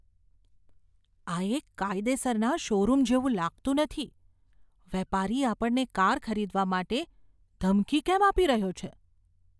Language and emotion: Gujarati, fearful